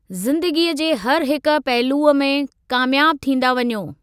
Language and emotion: Sindhi, neutral